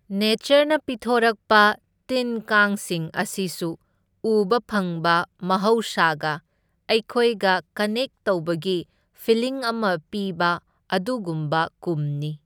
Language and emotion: Manipuri, neutral